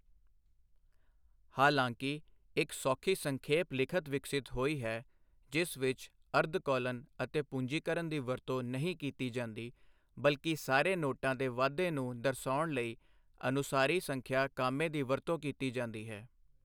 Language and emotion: Punjabi, neutral